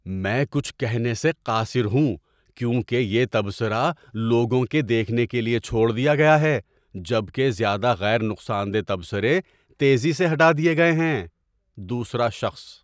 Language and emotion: Urdu, surprised